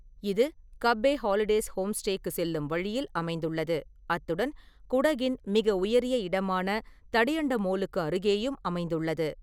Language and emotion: Tamil, neutral